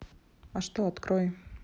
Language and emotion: Russian, neutral